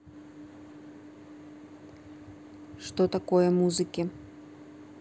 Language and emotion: Russian, neutral